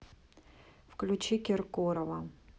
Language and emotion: Russian, neutral